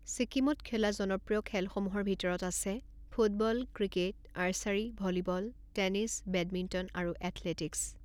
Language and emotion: Assamese, neutral